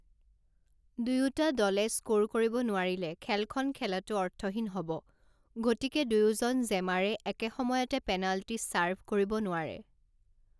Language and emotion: Assamese, neutral